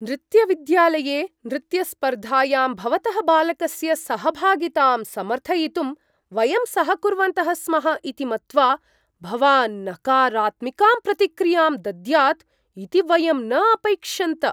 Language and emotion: Sanskrit, surprised